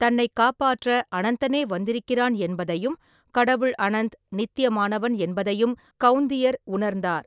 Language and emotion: Tamil, neutral